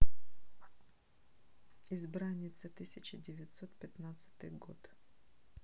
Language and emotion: Russian, neutral